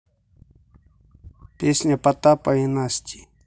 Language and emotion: Russian, neutral